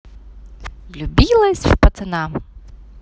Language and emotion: Russian, positive